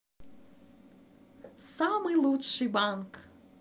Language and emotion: Russian, positive